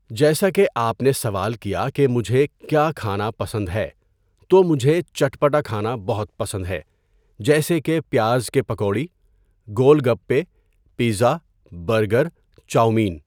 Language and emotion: Urdu, neutral